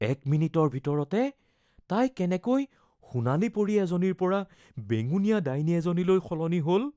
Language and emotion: Assamese, fearful